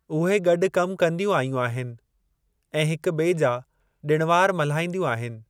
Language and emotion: Sindhi, neutral